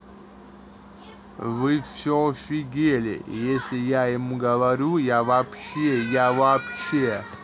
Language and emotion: Russian, angry